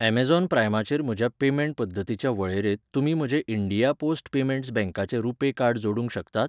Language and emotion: Goan Konkani, neutral